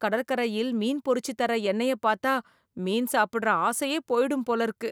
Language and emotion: Tamil, disgusted